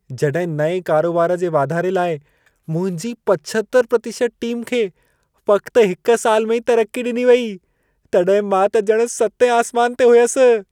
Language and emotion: Sindhi, happy